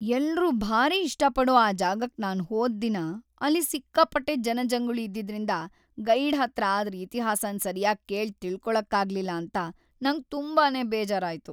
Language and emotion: Kannada, sad